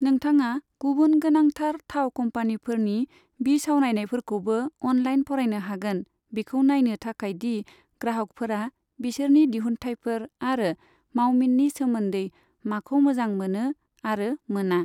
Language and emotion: Bodo, neutral